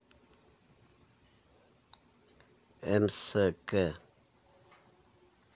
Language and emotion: Russian, neutral